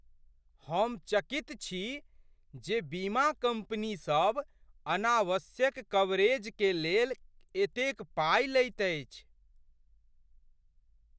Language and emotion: Maithili, surprised